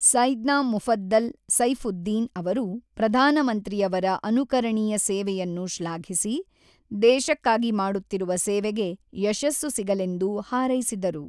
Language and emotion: Kannada, neutral